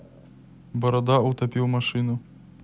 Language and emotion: Russian, neutral